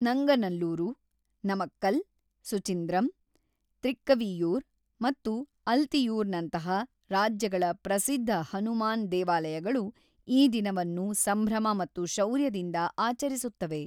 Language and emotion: Kannada, neutral